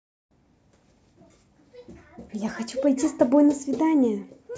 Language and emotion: Russian, positive